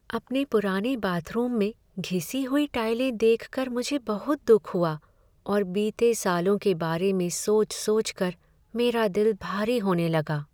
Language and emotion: Hindi, sad